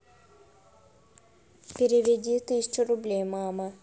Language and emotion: Russian, neutral